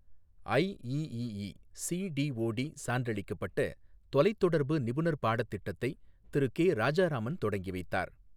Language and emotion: Tamil, neutral